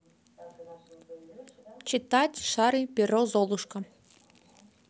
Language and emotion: Russian, neutral